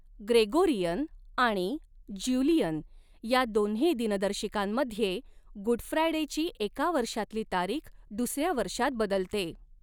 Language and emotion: Marathi, neutral